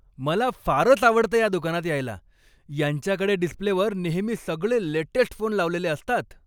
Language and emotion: Marathi, happy